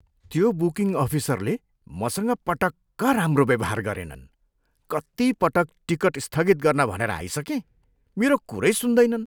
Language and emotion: Nepali, disgusted